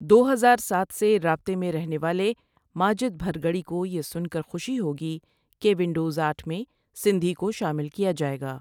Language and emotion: Urdu, neutral